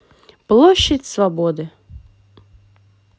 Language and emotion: Russian, neutral